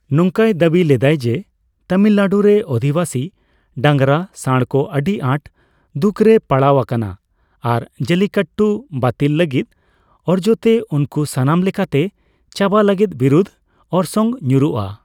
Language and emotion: Santali, neutral